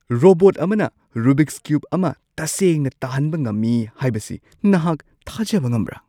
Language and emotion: Manipuri, surprised